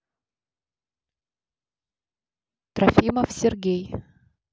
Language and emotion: Russian, neutral